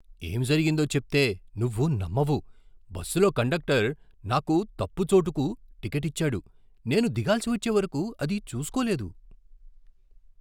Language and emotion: Telugu, surprised